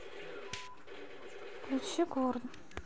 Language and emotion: Russian, neutral